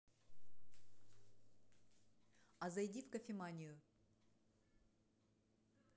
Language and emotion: Russian, neutral